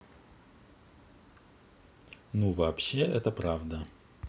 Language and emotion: Russian, neutral